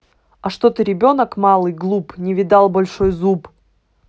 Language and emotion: Russian, angry